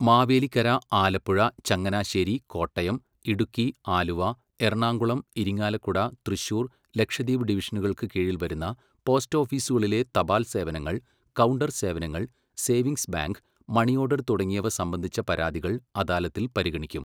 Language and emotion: Malayalam, neutral